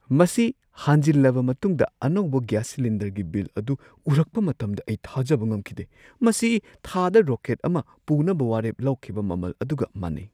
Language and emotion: Manipuri, surprised